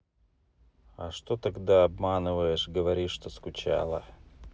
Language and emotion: Russian, neutral